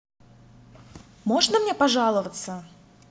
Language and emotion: Russian, neutral